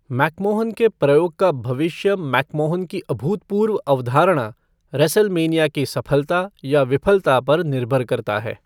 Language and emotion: Hindi, neutral